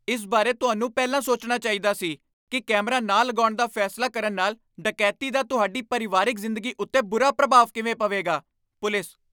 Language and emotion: Punjabi, angry